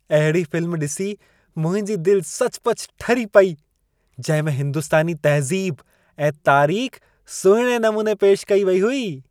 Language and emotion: Sindhi, happy